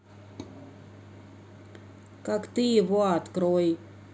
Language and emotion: Russian, neutral